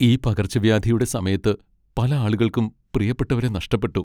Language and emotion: Malayalam, sad